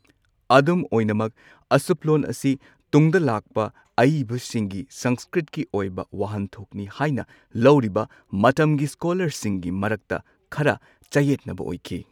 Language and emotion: Manipuri, neutral